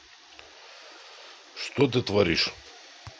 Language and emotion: Russian, neutral